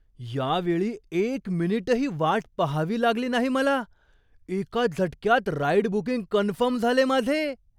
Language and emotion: Marathi, surprised